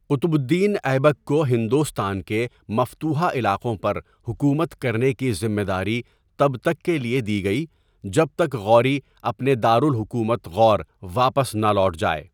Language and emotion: Urdu, neutral